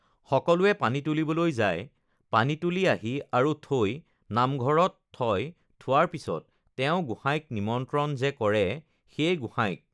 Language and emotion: Assamese, neutral